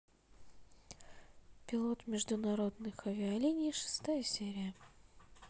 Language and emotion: Russian, neutral